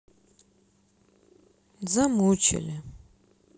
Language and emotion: Russian, sad